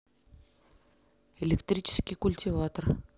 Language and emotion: Russian, neutral